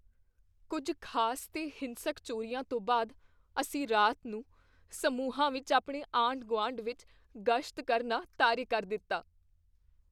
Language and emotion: Punjabi, fearful